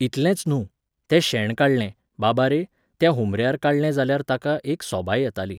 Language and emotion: Goan Konkani, neutral